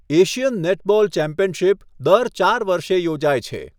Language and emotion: Gujarati, neutral